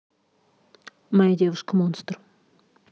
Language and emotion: Russian, neutral